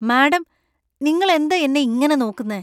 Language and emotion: Malayalam, disgusted